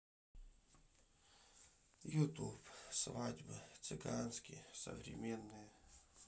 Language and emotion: Russian, sad